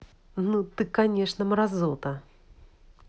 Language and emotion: Russian, angry